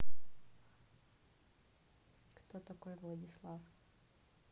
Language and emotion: Russian, neutral